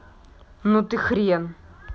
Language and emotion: Russian, angry